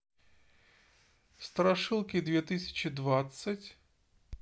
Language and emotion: Russian, neutral